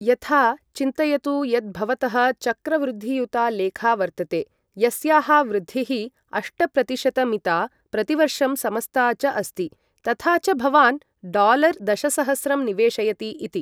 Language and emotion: Sanskrit, neutral